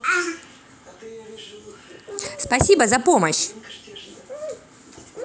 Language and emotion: Russian, positive